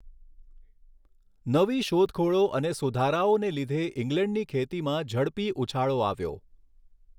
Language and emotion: Gujarati, neutral